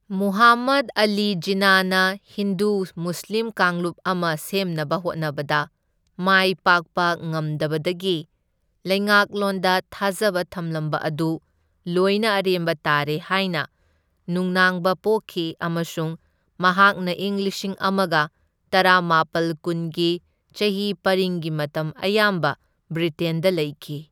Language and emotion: Manipuri, neutral